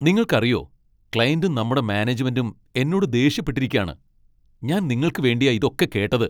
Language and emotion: Malayalam, angry